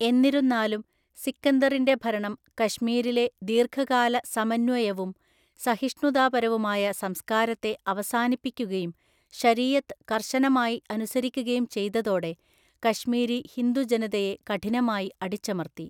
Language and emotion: Malayalam, neutral